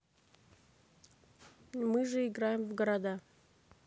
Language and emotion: Russian, neutral